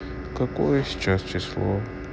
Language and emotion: Russian, sad